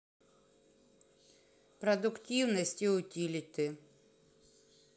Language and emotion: Russian, neutral